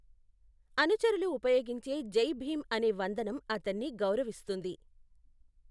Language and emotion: Telugu, neutral